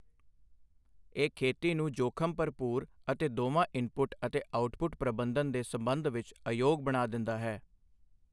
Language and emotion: Punjabi, neutral